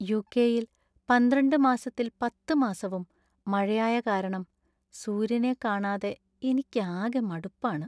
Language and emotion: Malayalam, sad